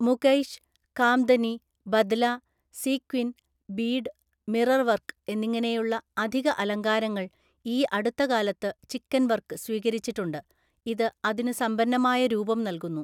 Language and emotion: Malayalam, neutral